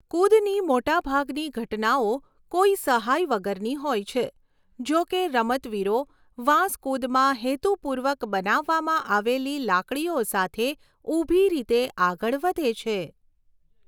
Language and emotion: Gujarati, neutral